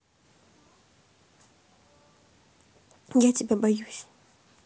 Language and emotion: Russian, neutral